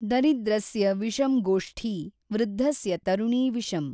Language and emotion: Kannada, neutral